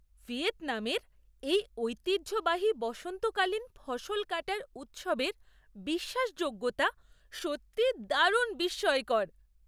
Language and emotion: Bengali, surprised